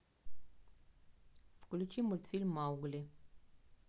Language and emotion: Russian, neutral